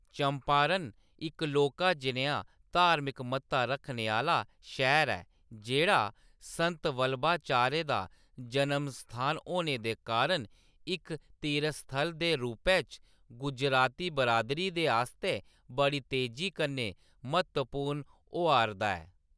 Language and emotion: Dogri, neutral